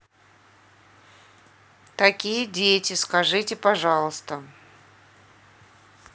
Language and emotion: Russian, neutral